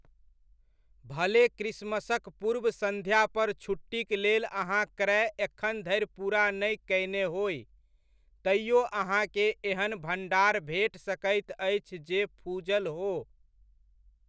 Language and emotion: Maithili, neutral